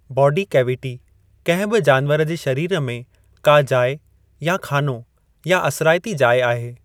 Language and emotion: Sindhi, neutral